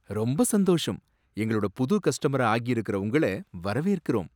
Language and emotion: Tamil, surprised